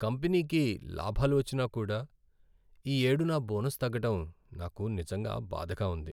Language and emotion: Telugu, sad